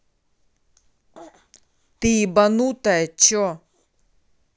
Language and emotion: Russian, angry